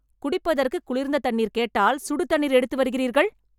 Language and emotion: Tamil, angry